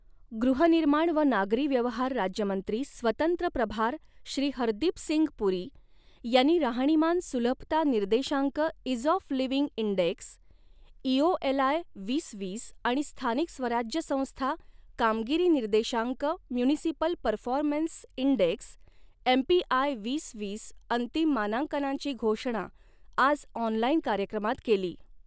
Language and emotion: Marathi, neutral